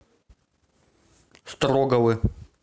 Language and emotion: Russian, neutral